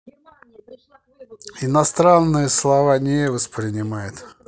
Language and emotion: Russian, neutral